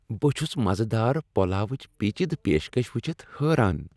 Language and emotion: Kashmiri, happy